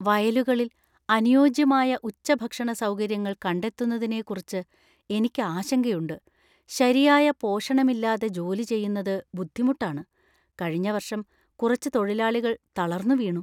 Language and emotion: Malayalam, fearful